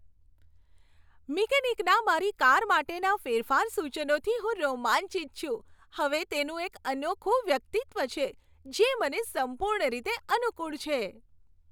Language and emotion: Gujarati, happy